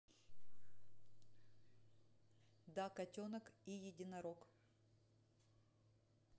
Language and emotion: Russian, neutral